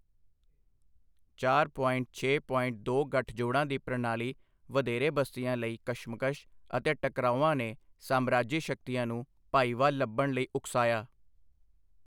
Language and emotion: Punjabi, neutral